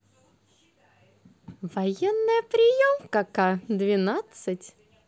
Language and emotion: Russian, positive